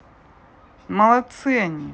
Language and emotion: Russian, positive